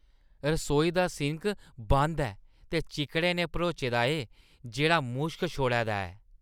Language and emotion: Dogri, disgusted